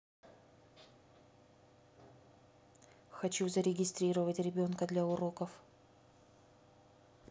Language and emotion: Russian, neutral